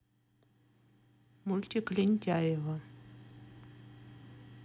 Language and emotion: Russian, neutral